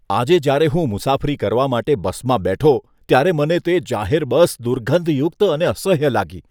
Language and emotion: Gujarati, disgusted